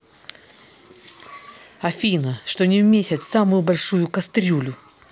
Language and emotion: Russian, angry